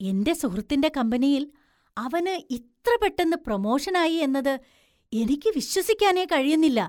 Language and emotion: Malayalam, surprised